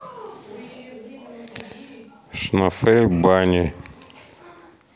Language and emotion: Russian, neutral